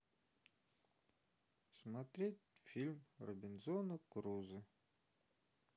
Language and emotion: Russian, sad